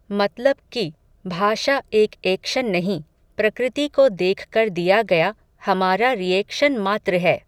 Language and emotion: Hindi, neutral